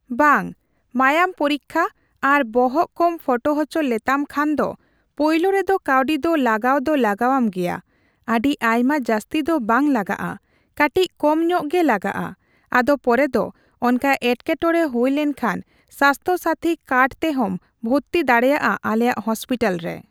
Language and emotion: Santali, neutral